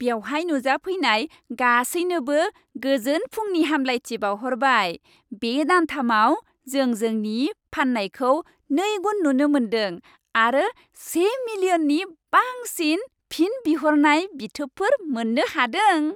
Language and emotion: Bodo, happy